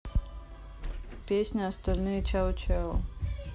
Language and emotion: Russian, neutral